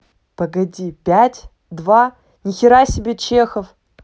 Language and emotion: Russian, neutral